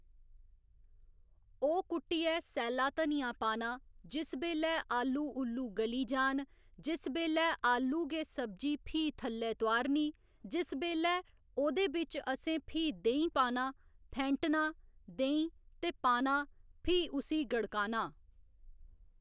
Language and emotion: Dogri, neutral